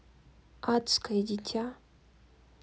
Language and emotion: Russian, neutral